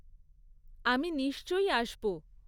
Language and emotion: Bengali, neutral